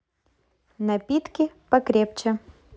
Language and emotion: Russian, positive